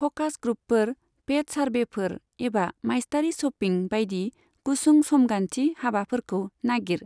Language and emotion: Bodo, neutral